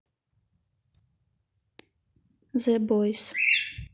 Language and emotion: Russian, neutral